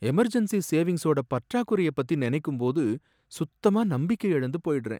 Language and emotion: Tamil, sad